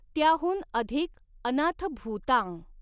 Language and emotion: Marathi, neutral